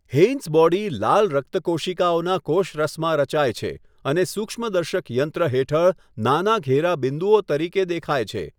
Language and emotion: Gujarati, neutral